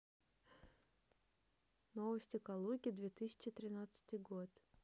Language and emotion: Russian, neutral